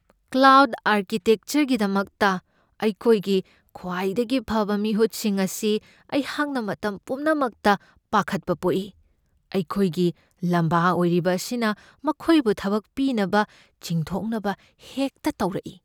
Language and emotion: Manipuri, fearful